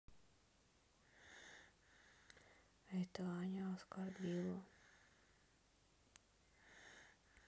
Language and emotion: Russian, sad